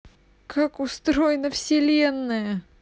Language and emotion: Russian, sad